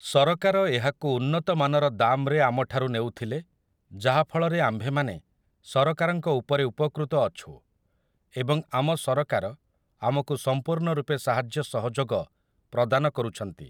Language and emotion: Odia, neutral